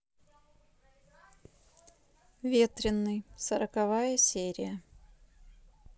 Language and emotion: Russian, neutral